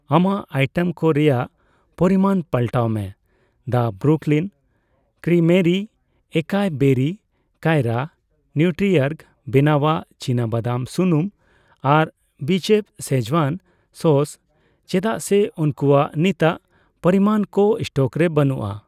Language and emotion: Santali, neutral